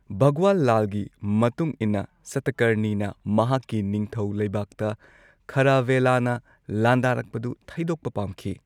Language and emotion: Manipuri, neutral